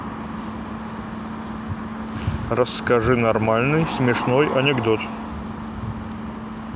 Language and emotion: Russian, neutral